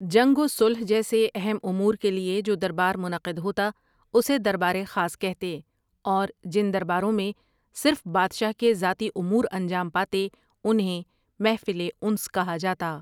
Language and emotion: Urdu, neutral